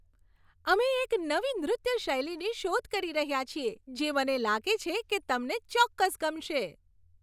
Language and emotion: Gujarati, happy